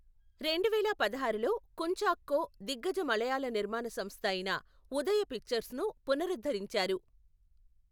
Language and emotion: Telugu, neutral